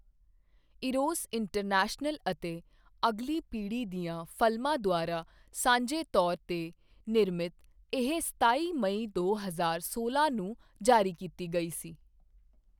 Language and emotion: Punjabi, neutral